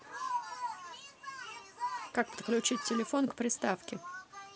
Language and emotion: Russian, neutral